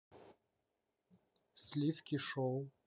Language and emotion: Russian, neutral